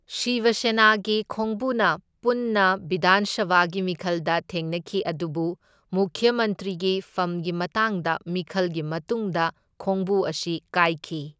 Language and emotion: Manipuri, neutral